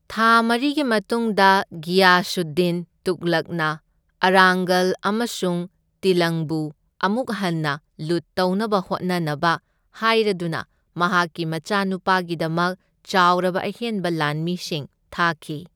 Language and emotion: Manipuri, neutral